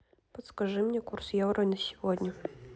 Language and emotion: Russian, neutral